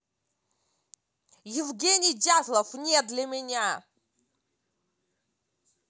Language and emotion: Russian, angry